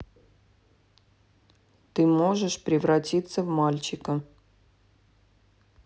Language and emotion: Russian, neutral